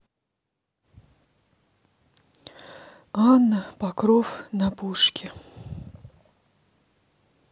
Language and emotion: Russian, sad